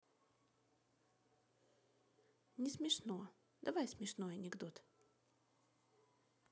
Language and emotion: Russian, neutral